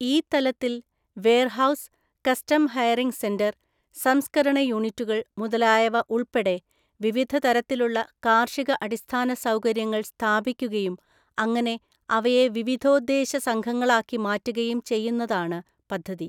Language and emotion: Malayalam, neutral